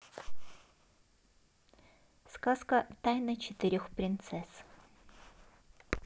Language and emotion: Russian, neutral